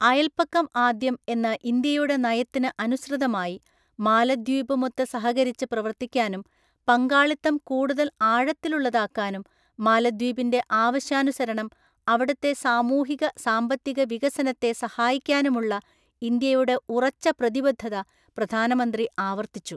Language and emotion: Malayalam, neutral